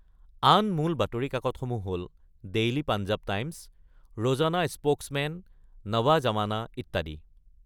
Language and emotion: Assamese, neutral